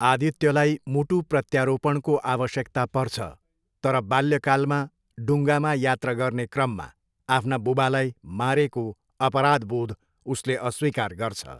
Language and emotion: Nepali, neutral